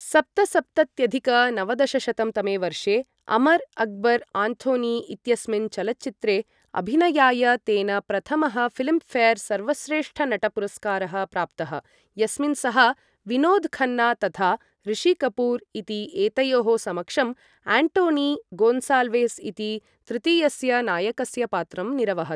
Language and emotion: Sanskrit, neutral